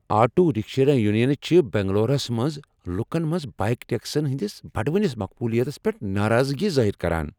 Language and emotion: Kashmiri, angry